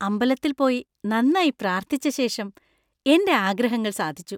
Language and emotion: Malayalam, happy